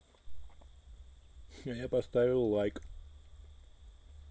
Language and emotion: Russian, neutral